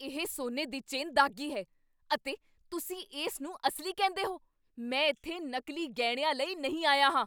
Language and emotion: Punjabi, angry